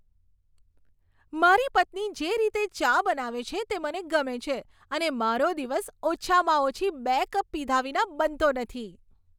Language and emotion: Gujarati, happy